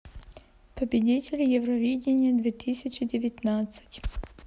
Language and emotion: Russian, neutral